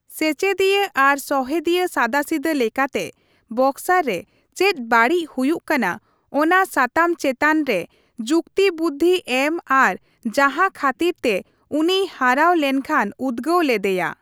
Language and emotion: Santali, neutral